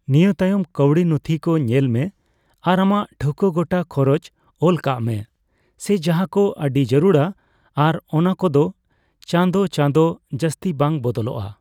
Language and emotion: Santali, neutral